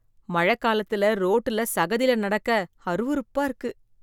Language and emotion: Tamil, disgusted